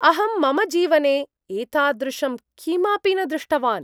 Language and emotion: Sanskrit, surprised